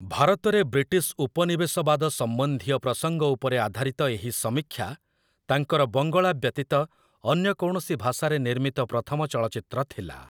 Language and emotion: Odia, neutral